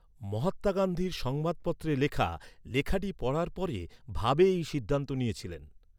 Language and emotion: Bengali, neutral